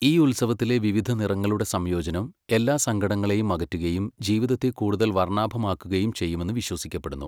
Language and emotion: Malayalam, neutral